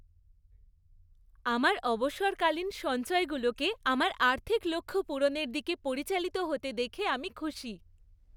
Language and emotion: Bengali, happy